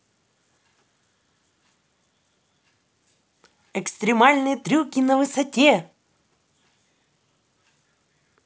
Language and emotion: Russian, positive